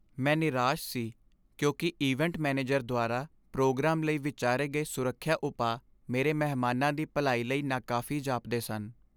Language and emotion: Punjabi, sad